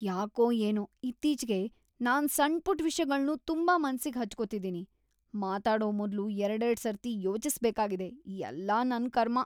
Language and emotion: Kannada, disgusted